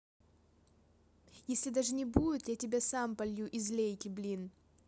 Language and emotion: Russian, neutral